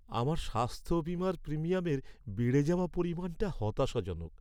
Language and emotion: Bengali, sad